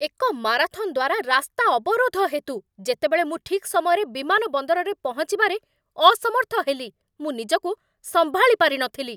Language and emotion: Odia, angry